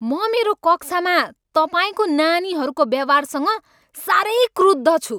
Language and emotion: Nepali, angry